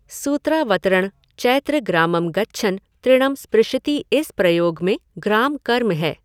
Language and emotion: Hindi, neutral